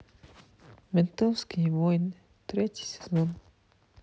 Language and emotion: Russian, sad